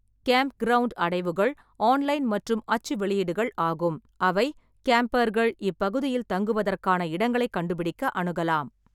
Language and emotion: Tamil, neutral